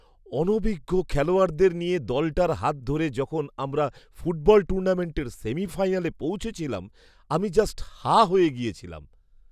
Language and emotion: Bengali, surprised